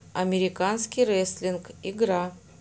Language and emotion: Russian, neutral